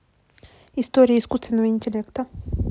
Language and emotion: Russian, neutral